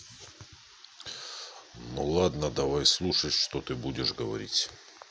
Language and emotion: Russian, neutral